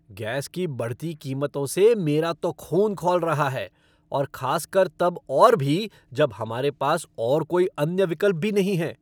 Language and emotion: Hindi, angry